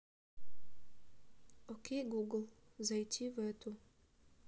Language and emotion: Russian, neutral